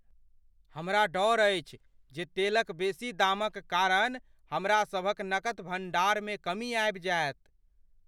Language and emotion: Maithili, fearful